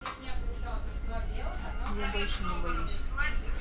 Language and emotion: Russian, neutral